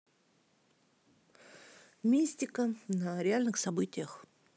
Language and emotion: Russian, neutral